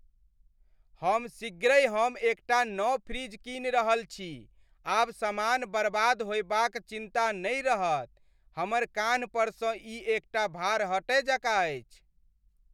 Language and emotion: Maithili, happy